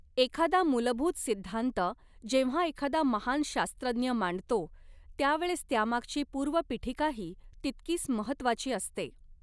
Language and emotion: Marathi, neutral